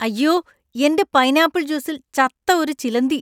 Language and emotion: Malayalam, disgusted